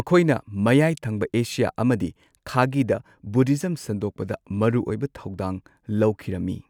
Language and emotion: Manipuri, neutral